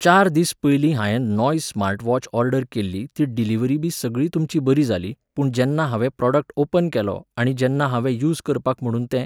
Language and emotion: Goan Konkani, neutral